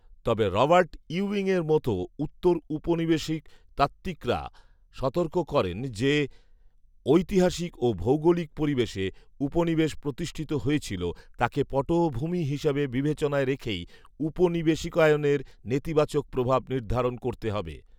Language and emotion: Bengali, neutral